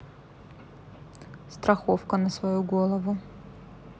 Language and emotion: Russian, neutral